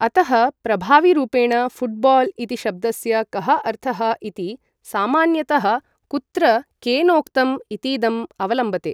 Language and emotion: Sanskrit, neutral